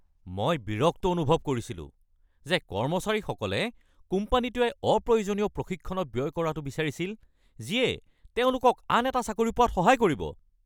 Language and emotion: Assamese, angry